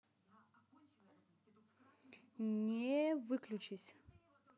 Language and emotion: Russian, positive